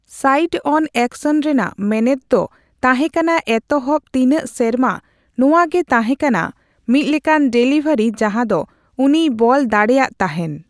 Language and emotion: Santali, neutral